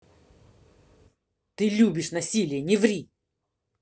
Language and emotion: Russian, angry